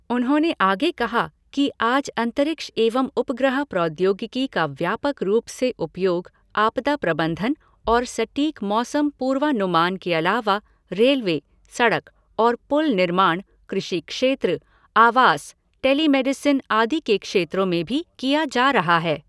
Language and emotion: Hindi, neutral